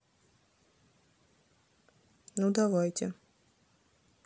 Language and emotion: Russian, neutral